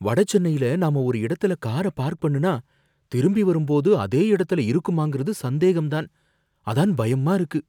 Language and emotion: Tamil, fearful